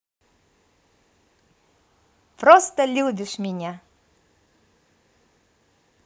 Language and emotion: Russian, positive